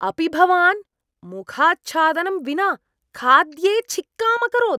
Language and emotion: Sanskrit, disgusted